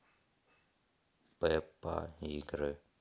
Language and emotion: Russian, neutral